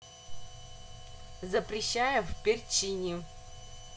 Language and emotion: Russian, neutral